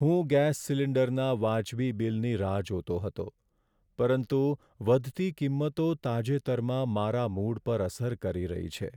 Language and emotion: Gujarati, sad